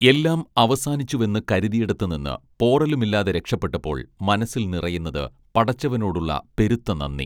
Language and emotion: Malayalam, neutral